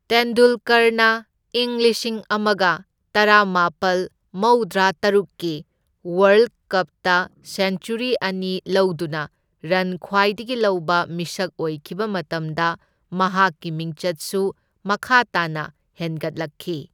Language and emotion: Manipuri, neutral